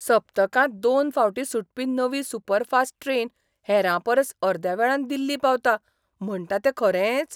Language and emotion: Goan Konkani, surprised